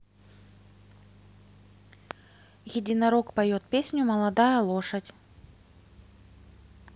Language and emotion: Russian, neutral